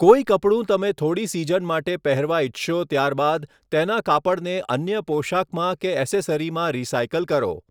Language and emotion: Gujarati, neutral